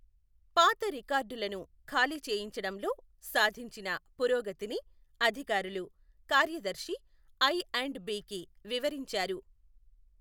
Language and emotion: Telugu, neutral